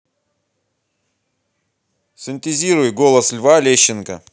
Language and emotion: Russian, neutral